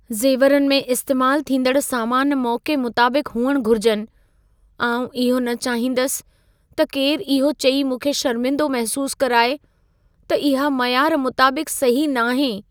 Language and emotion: Sindhi, fearful